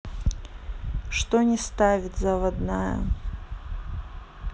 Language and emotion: Russian, neutral